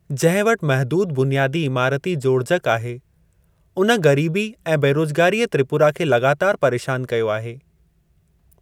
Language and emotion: Sindhi, neutral